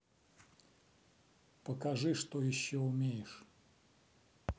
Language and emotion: Russian, neutral